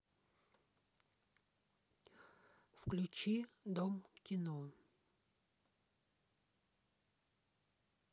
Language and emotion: Russian, neutral